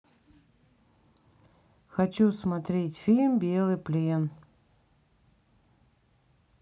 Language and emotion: Russian, neutral